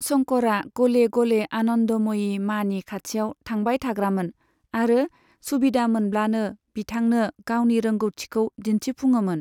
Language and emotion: Bodo, neutral